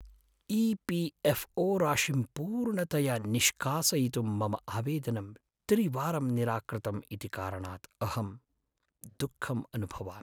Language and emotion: Sanskrit, sad